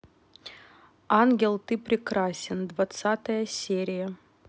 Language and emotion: Russian, neutral